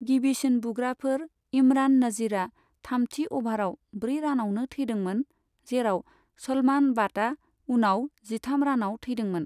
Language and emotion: Bodo, neutral